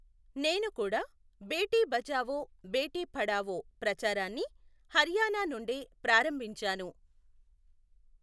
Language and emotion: Telugu, neutral